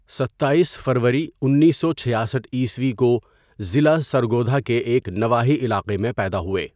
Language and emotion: Urdu, neutral